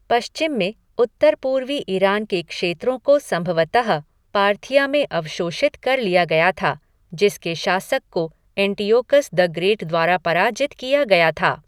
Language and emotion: Hindi, neutral